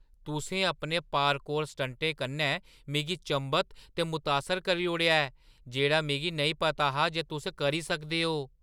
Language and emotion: Dogri, surprised